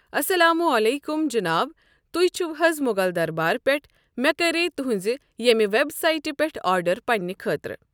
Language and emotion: Kashmiri, neutral